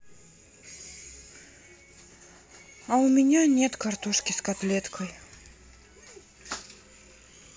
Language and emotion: Russian, sad